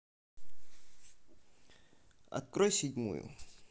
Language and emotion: Russian, neutral